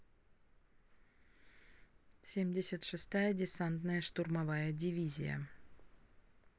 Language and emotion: Russian, neutral